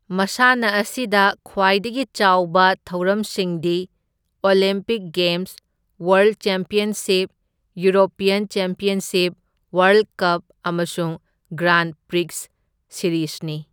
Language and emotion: Manipuri, neutral